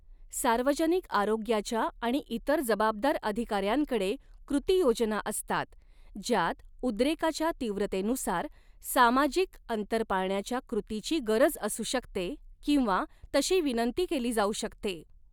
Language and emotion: Marathi, neutral